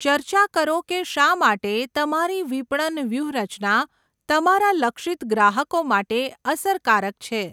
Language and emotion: Gujarati, neutral